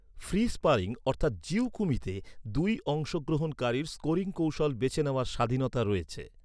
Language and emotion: Bengali, neutral